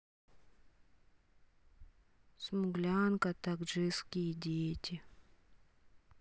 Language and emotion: Russian, sad